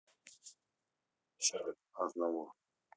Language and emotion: Russian, neutral